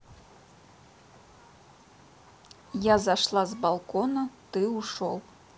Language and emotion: Russian, neutral